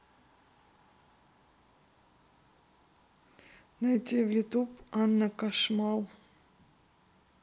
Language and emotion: Russian, neutral